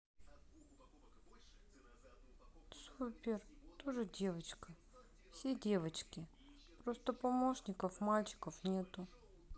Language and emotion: Russian, sad